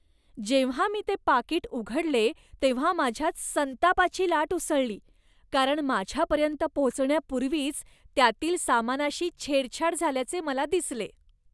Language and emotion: Marathi, disgusted